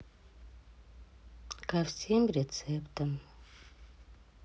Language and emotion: Russian, sad